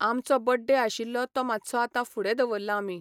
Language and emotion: Goan Konkani, neutral